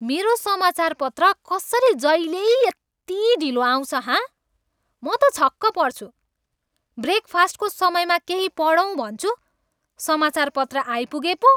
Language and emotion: Nepali, angry